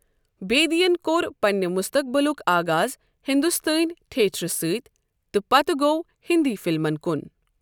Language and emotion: Kashmiri, neutral